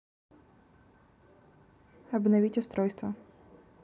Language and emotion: Russian, neutral